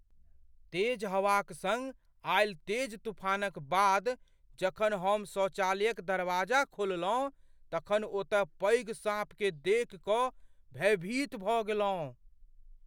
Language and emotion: Maithili, fearful